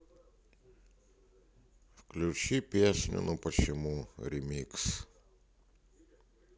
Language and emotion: Russian, sad